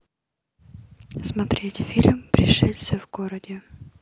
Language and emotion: Russian, neutral